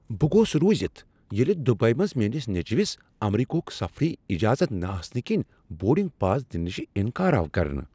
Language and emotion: Kashmiri, surprised